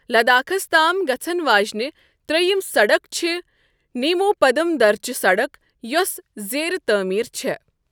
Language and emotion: Kashmiri, neutral